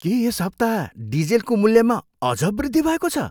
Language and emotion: Nepali, surprised